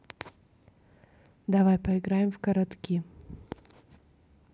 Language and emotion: Russian, neutral